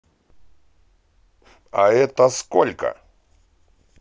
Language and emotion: Russian, positive